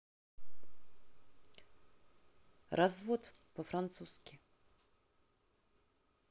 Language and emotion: Russian, neutral